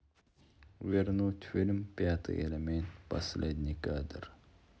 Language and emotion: Russian, sad